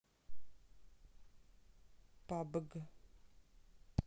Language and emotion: Russian, neutral